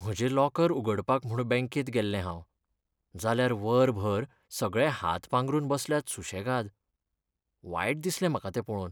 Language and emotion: Goan Konkani, sad